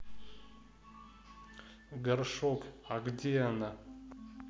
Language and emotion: Russian, neutral